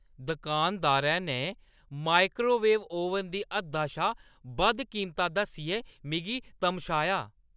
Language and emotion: Dogri, angry